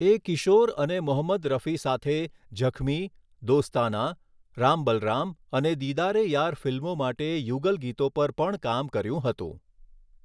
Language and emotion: Gujarati, neutral